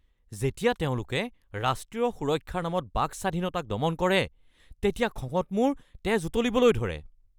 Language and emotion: Assamese, angry